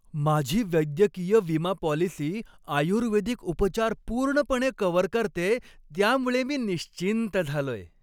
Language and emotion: Marathi, happy